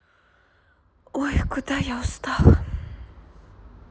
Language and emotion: Russian, sad